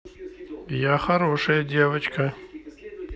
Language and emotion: Russian, neutral